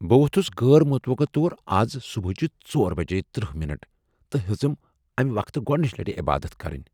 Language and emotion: Kashmiri, surprised